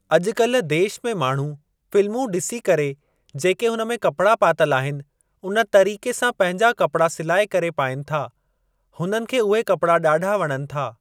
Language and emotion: Sindhi, neutral